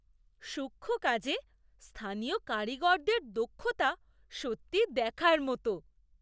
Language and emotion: Bengali, surprised